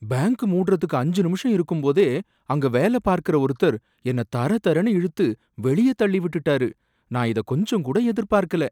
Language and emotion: Tamil, surprised